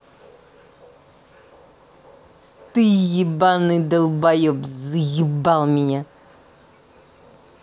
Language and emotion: Russian, angry